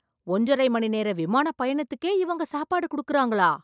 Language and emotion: Tamil, surprised